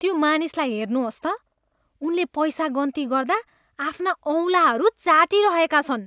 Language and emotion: Nepali, disgusted